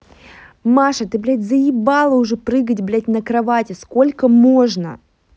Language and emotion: Russian, angry